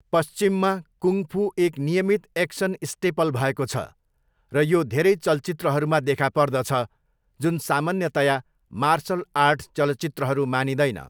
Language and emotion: Nepali, neutral